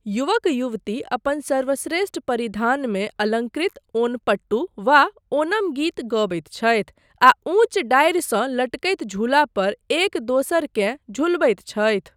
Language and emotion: Maithili, neutral